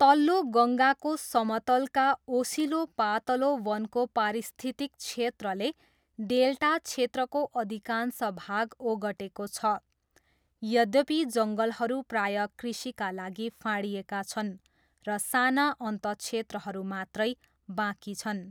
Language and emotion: Nepali, neutral